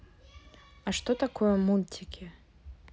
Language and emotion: Russian, neutral